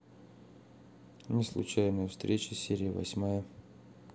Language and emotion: Russian, neutral